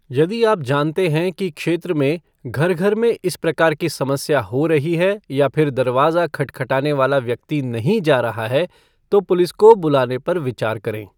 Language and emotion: Hindi, neutral